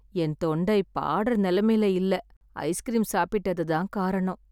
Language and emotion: Tamil, sad